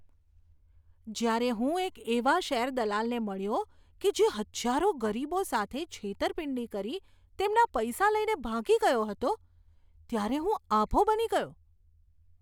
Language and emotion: Gujarati, disgusted